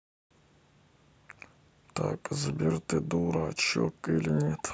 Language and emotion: Russian, angry